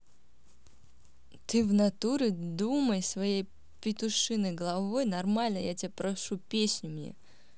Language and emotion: Russian, angry